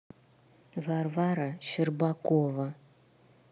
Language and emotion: Russian, neutral